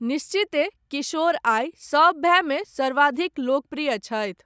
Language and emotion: Maithili, neutral